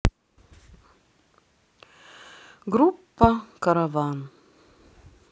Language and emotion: Russian, sad